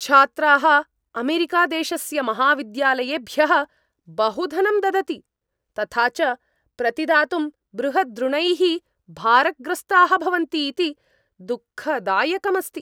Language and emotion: Sanskrit, angry